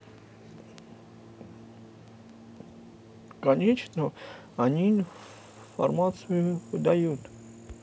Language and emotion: Russian, neutral